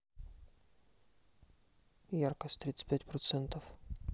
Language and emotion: Russian, neutral